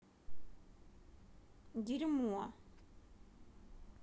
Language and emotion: Russian, angry